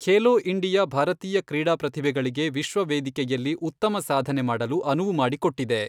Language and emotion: Kannada, neutral